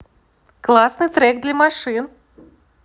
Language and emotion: Russian, positive